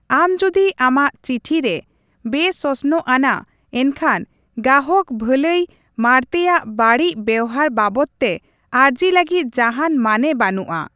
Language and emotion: Santali, neutral